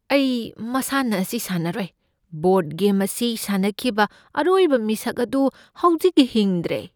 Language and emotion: Manipuri, fearful